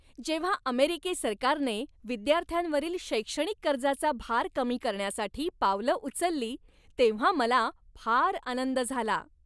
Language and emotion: Marathi, happy